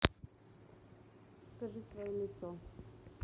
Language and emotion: Russian, neutral